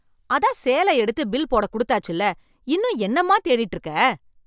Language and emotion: Tamil, angry